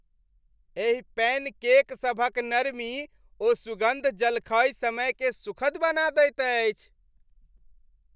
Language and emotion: Maithili, happy